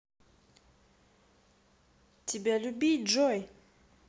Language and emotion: Russian, positive